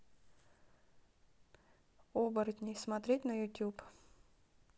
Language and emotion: Russian, neutral